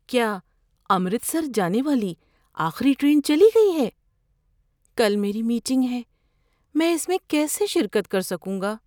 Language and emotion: Urdu, fearful